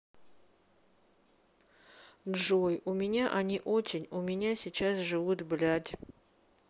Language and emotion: Russian, sad